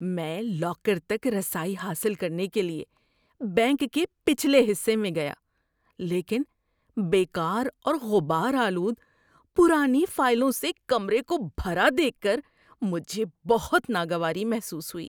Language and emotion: Urdu, disgusted